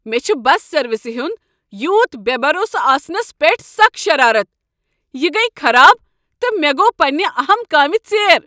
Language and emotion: Kashmiri, angry